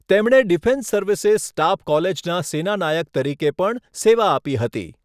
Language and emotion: Gujarati, neutral